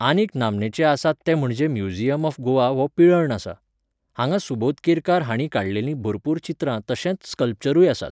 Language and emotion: Goan Konkani, neutral